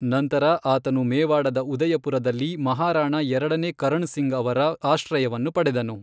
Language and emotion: Kannada, neutral